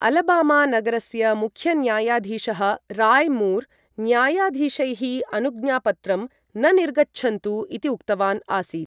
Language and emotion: Sanskrit, neutral